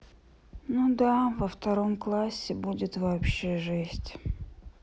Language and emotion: Russian, sad